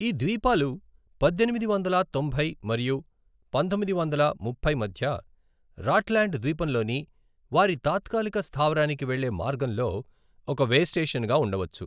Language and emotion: Telugu, neutral